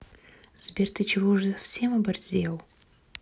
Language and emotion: Russian, neutral